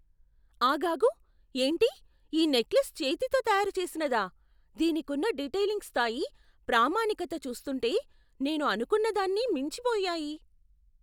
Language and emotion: Telugu, surprised